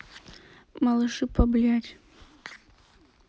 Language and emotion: Russian, sad